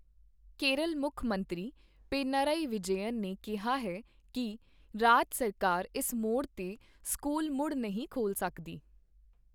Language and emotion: Punjabi, neutral